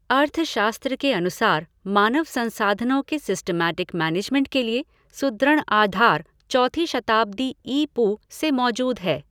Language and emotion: Hindi, neutral